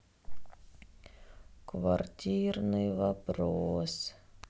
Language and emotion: Russian, sad